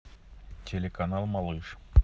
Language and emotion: Russian, neutral